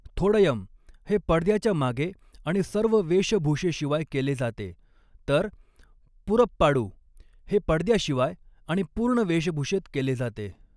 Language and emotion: Marathi, neutral